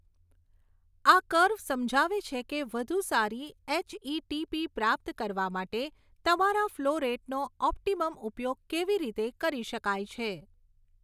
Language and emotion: Gujarati, neutral